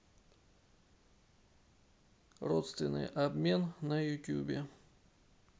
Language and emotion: Russian, neutral